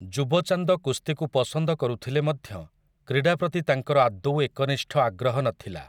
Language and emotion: Odia, neutral